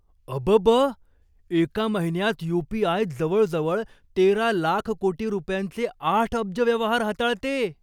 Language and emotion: Marathi, surprised